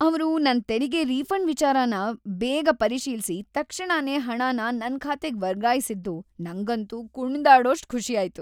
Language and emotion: Kannada, happy